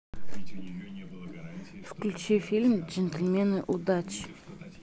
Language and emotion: Russian, neutral